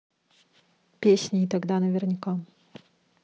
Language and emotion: Russian, neutral